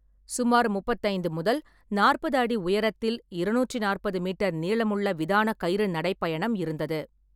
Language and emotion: Tamil, neutral